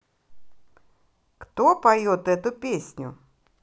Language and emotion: Russian, positive